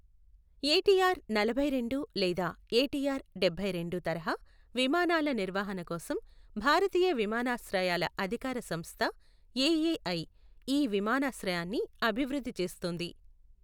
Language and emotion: Telugu, neutral